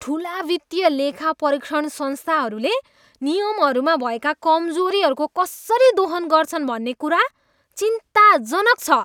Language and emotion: Nepali, disgusted